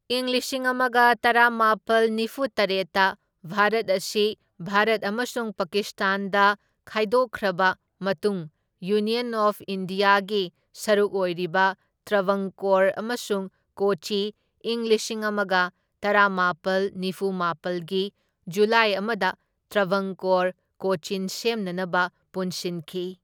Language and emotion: Manipuri, neutral